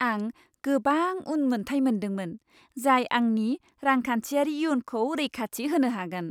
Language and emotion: Bodo, happy